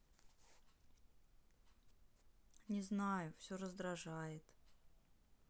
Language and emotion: Russian, sad